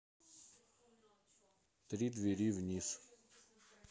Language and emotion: Russian, neutral